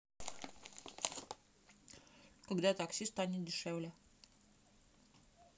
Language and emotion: Russian, neutral